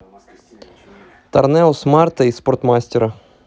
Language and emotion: Russian, neutral